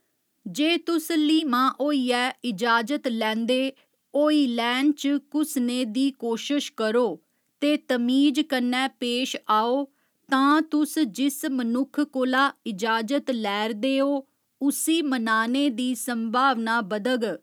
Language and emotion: Dogri, neutral